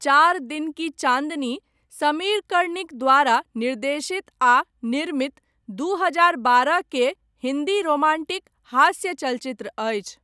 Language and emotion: Maithili, neutral